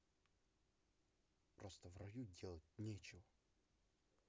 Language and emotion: Russian, neutral